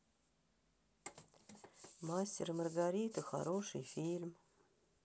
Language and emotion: Russian, sad